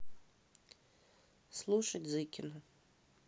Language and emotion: Russian, neutral